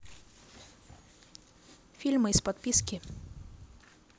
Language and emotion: Russian, neutral